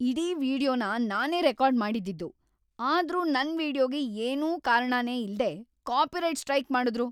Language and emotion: Kannada, angry